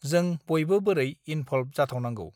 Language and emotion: Bodo, neutral